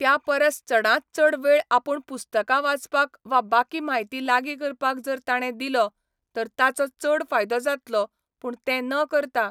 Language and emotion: Goan Konkani, neutral